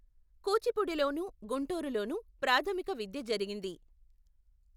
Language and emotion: Telugu, neutral